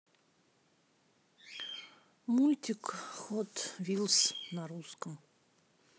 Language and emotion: Russian, sad